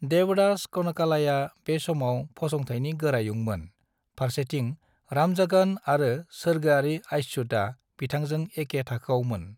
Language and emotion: Bodo, neutral